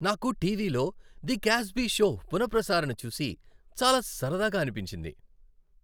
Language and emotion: Telugu, happy